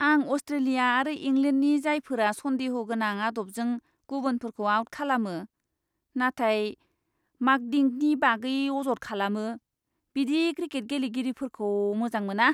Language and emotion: Bodo, disgusted